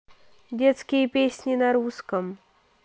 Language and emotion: Russian, neutral